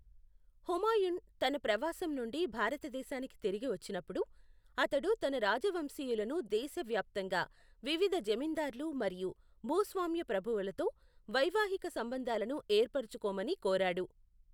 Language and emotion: Telugu, neutral